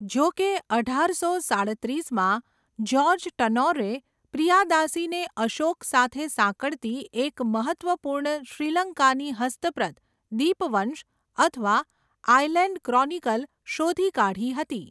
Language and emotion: Gujarati, neutral